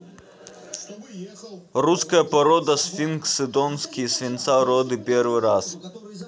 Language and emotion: Russian, neutral